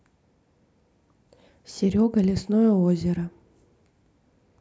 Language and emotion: Russian, neutral